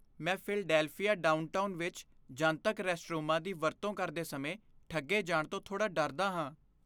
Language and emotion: Punjabi, fearful